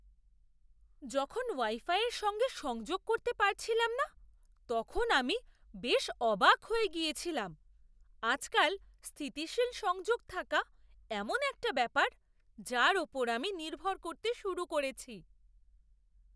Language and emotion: Bengali, surprised